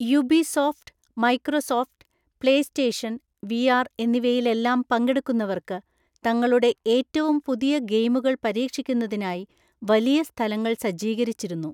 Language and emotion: Malayalam, neutral